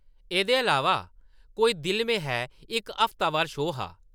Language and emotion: Dogri, neutral